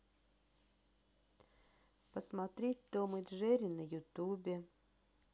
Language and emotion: Russian, sad